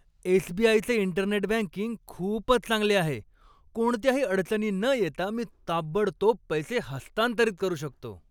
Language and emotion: Marathi, happy